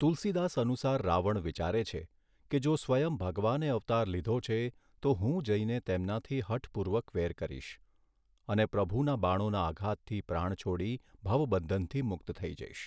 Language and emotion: Gujarati, neutral